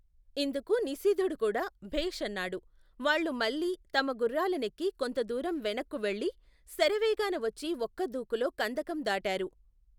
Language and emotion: Telugu, neutral